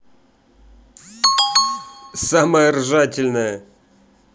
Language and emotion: Russian, positive